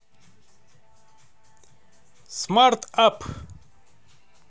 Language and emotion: Russian, positive